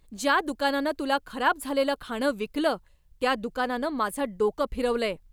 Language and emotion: Marathi, angry